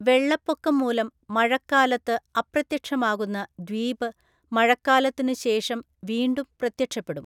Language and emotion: Malayalam, neutral